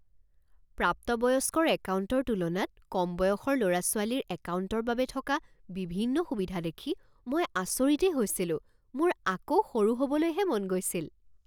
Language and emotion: Assamese, surprised